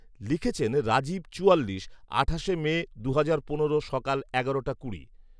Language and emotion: Bengali, neutral